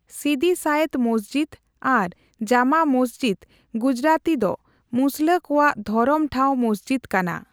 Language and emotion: Santali, neutral